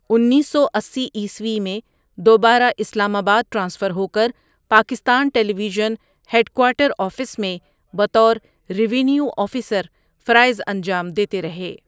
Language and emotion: Urdu, neutral